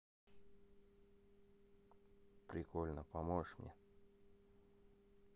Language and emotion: Russian, neutral